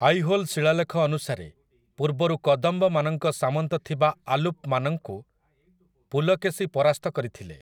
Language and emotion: Odia, neutral